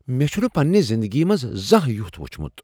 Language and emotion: Kashmiri, surprised